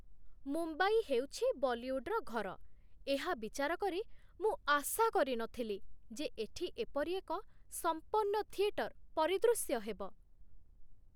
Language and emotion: Odia, surprised